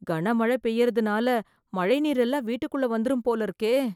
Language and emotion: Tamil, fearful